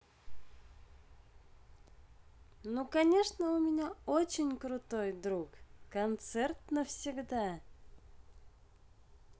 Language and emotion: Russian, positive